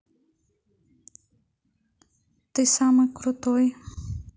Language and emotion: Russian, neutral